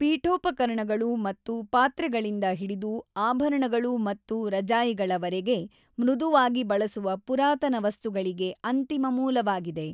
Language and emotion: Kannada, neutral